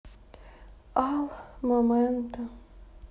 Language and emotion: Russian, sad